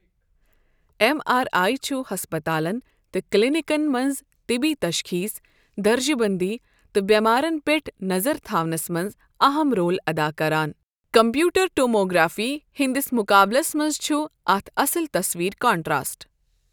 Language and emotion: Kashmiri, neutral